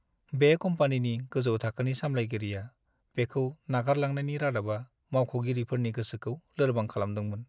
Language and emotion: Bodo, sad